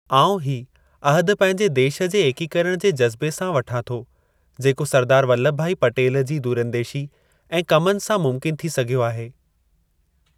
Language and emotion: Sindhi, neutral